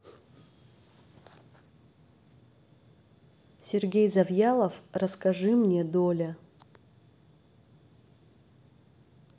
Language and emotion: Russian, neutral